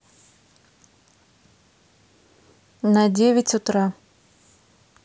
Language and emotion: Russian, neutral